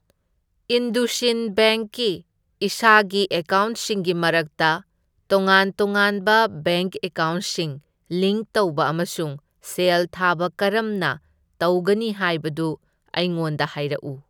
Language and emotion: Manipuri, neutral